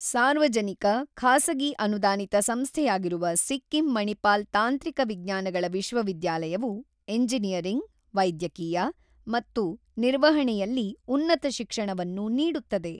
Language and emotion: Kannada, neutral